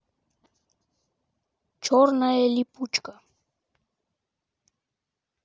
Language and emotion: Russian, neutral